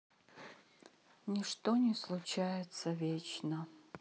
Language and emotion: Russian, sad